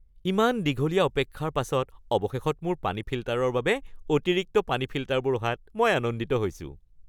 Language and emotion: Assamese, happy